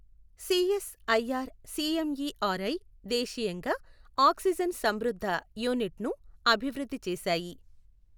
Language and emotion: Telugu, neutral